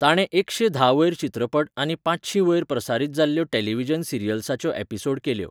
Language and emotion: Goan Konkani, neutral